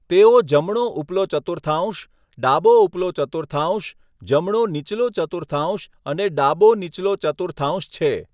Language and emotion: Gujarati, neutral